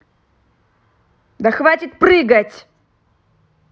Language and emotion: Russian, angry